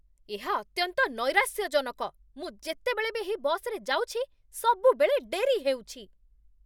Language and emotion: Odia, angry